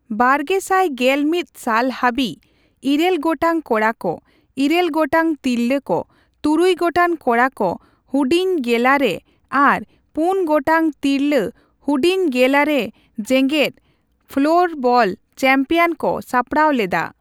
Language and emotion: Santali, neutral